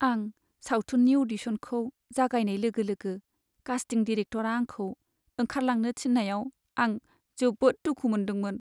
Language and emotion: Bodo, sad